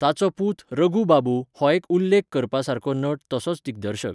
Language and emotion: Goan Konkani, neutral